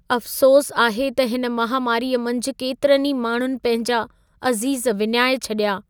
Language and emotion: Sindhi, sad